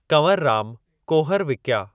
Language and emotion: Sindhi, neutral